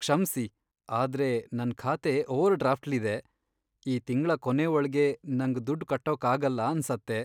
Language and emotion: Kannada, sad